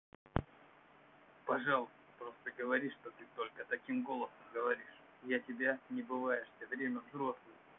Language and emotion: Russian, neutral